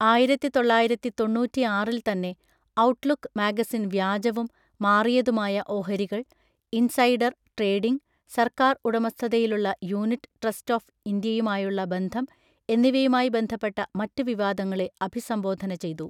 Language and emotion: Malayalam, neutral